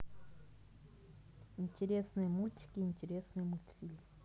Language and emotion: Russian, neutral